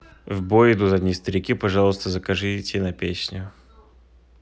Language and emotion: Russian, neutral